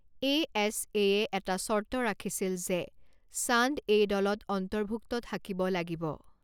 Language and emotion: Assamese, neutral